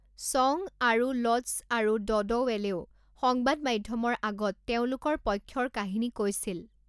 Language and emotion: Assamese, neutral